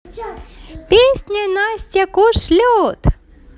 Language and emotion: Russian, positive